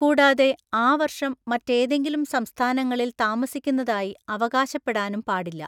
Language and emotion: Malayalam, neutral